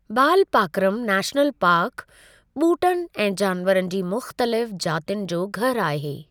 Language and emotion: Sindhi, neutral